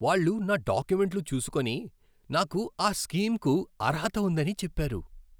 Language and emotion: Telugu, happy